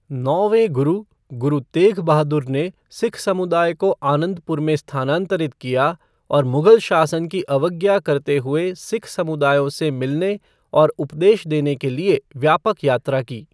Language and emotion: Hindi, neutral